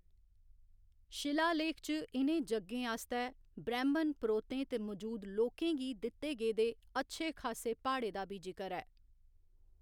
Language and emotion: Dogri, neutral